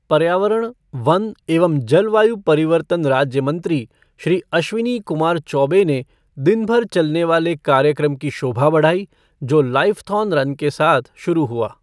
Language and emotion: Hindi, neutral